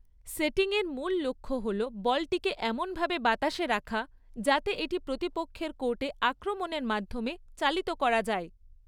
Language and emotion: Bengali, neutral